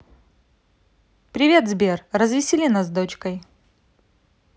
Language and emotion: Russian, positive